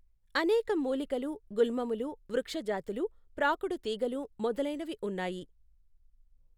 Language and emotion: Telugu, neutral